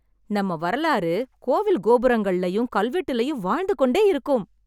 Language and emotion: Tamil, happy